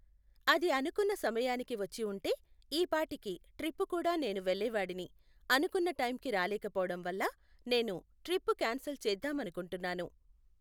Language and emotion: Telugu, neutral